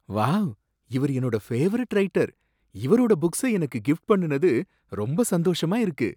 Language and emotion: Tamil, surprised